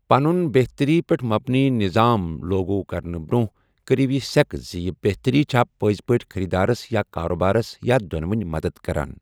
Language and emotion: Kashmiri, neutral